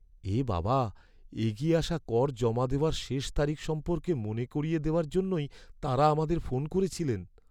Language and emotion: Bengali, sad